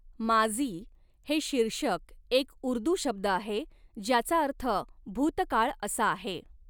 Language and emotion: Marathi, neutral